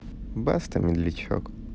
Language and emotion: Russian, neutral